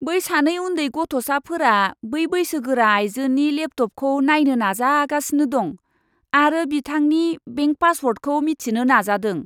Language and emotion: Bodo, disgusted